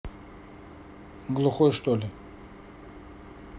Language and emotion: Russian, neutral